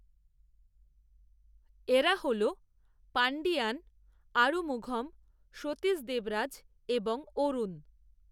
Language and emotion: Bengali, neutral